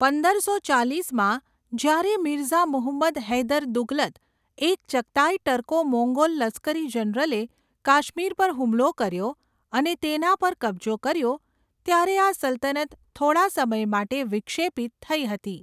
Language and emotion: Gujarati, neutral